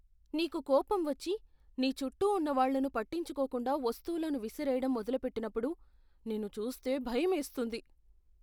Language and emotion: Telugu, fearful